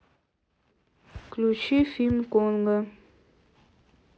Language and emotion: Russian, neutral